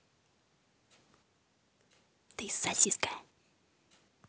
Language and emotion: Russian, neutral